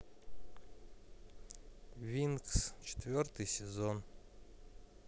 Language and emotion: Russian, sad